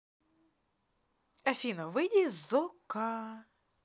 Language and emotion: Russian, positive